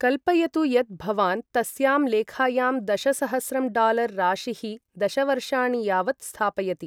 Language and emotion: Sanskrit, neutral